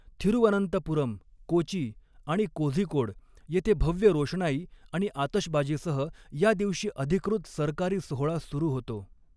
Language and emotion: Marathi, neutral